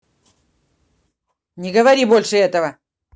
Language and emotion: Russian, angry